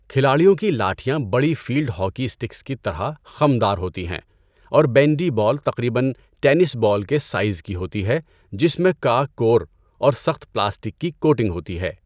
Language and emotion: Urdu, neutral